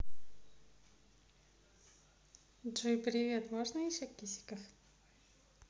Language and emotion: Russian, positive